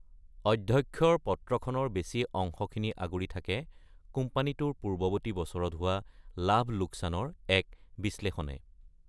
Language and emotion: Assamese, neutral